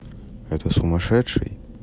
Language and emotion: Russian, neutral